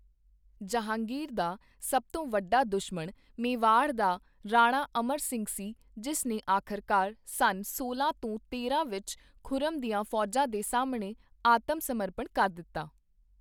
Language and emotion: Punjabi, neutral